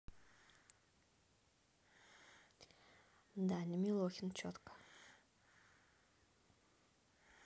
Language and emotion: Russian, neutral